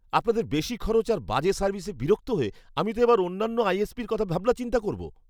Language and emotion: Bengali, angry